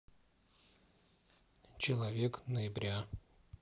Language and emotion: Russian, neutral